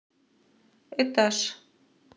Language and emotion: Russian, neutral